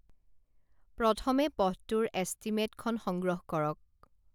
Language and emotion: Assamese, neutral